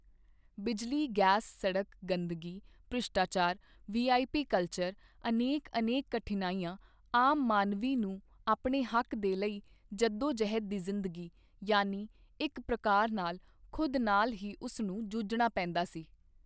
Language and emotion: Punjabi, neutral